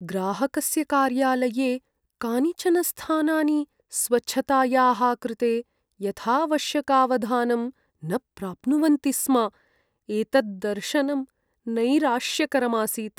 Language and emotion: Sanskrit, sad